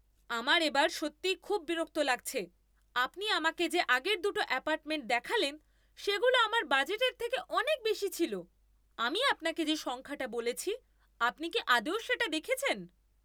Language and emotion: Bengali, angry